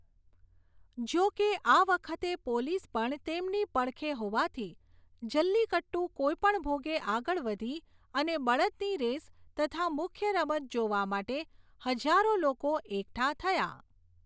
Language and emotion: Gujarati, neutral